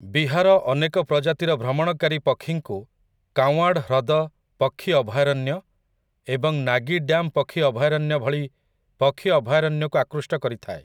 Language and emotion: Odia, neutral